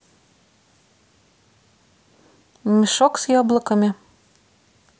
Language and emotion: Russian, neutral